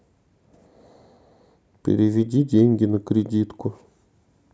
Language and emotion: Russian, neutral